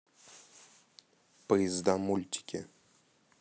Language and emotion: Russian, neutral